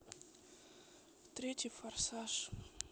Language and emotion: Russian, sad